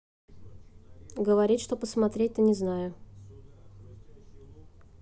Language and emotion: Russian, neutral